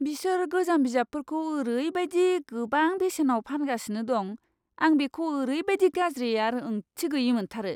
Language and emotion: Bodo, disgusted